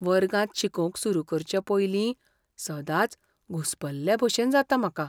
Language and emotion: Goan Konkani, fearful